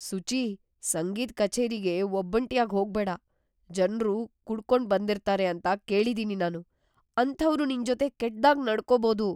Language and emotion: Kannada, fearful